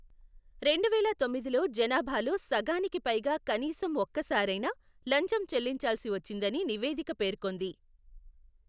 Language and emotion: Telugu, neutral